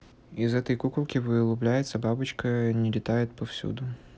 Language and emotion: Russian, neutral